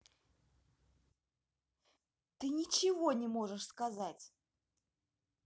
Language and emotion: Russian, angry